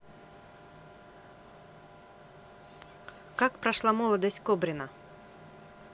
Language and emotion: Russian, neutral